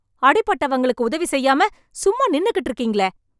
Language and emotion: Tamil, angry